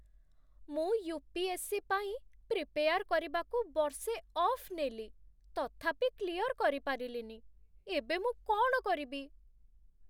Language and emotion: Odia, sad